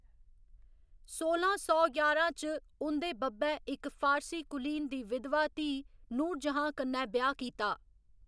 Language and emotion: Dogri, neutral